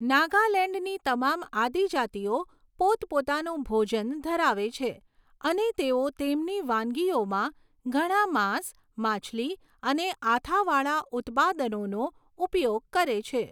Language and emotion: Gujarati, neutral